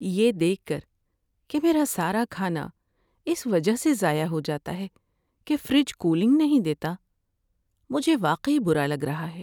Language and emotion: Urdu, sad